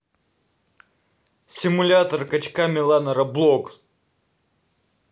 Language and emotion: Russian, angry